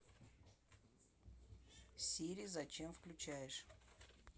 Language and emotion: Russian, neutral